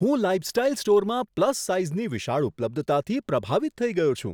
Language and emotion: Gujarati, surprised